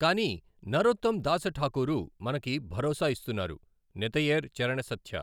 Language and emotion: Telugu, neutral